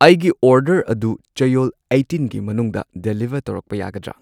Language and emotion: Manipuri, neutral